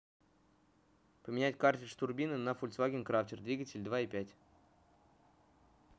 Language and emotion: Russian, neutral